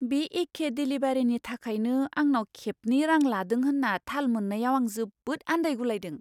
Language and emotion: Bodo, surprised